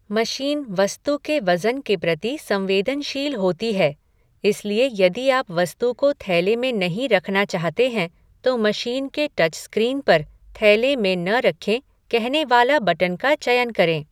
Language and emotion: Hindi, neutral